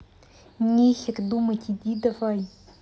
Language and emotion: Russian, angry